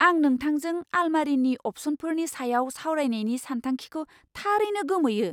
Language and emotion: Bodo, surprised